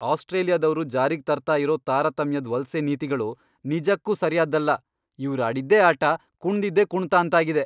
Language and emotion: Kannada, angry